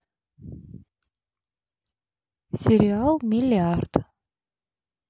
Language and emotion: Russian, neutral